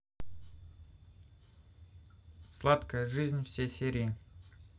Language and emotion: Russian, neutral